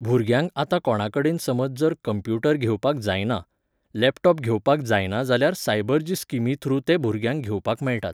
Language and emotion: Goan Konkani, neutral